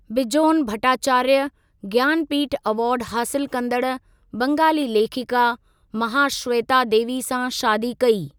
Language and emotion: Sindhi, neutral